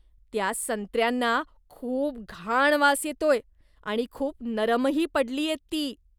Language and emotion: Marathi, disgusted